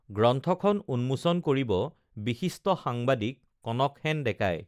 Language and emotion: Assamese, neutral